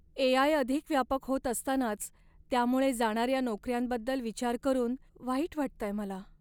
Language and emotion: Marathi, sad